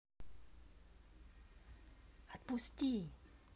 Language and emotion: Russian, neutral